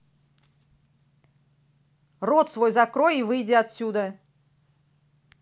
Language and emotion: Russian, angry